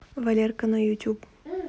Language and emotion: Russian, neutral